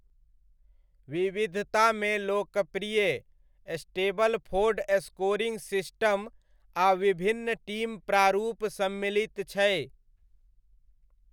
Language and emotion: Maithili, neutral